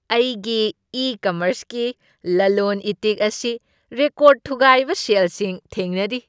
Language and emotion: Manipuri, happy